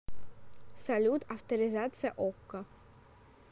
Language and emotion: Russian, neutral